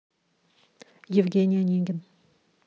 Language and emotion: Russian, neutral